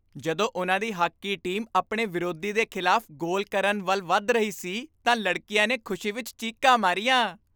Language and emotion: Punjabi, happy